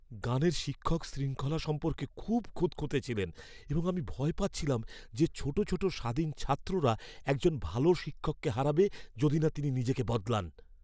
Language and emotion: Bengali, fearful